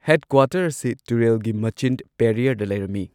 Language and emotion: Manipuri, neutral